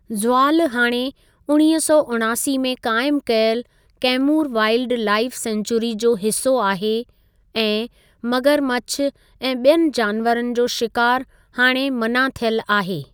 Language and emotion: Sindhi, neutral